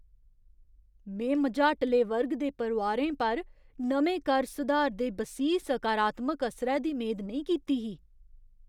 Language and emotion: Dogri, surprised